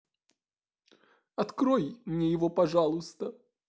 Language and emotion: Russian, sad